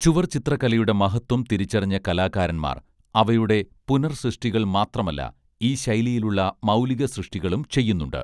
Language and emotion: Malayalam, neutral